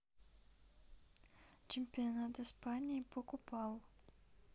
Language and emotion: Russian, neutral